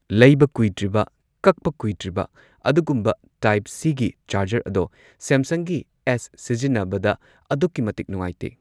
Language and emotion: Manipuri, neutral